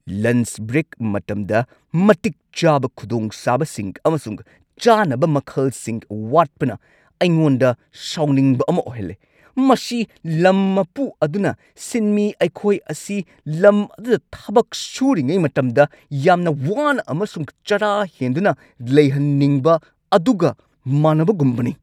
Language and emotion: Manipuri, angry